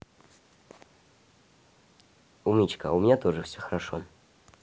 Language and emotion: Russian, positive